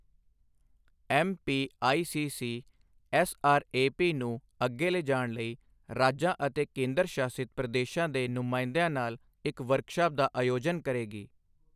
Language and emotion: Punjabi, neutral